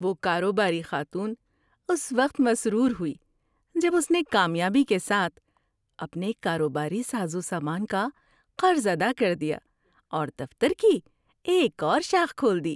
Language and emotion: Urdu, happy